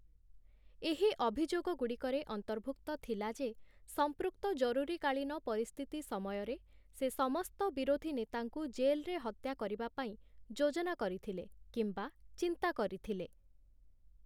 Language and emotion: Odia, neutral